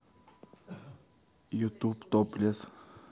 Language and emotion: Russian, neutral